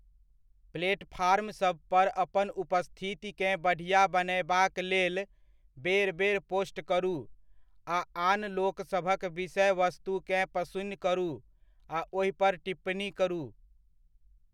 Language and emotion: Maithili, neutral